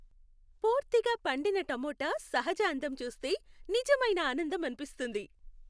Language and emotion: Telugu, happy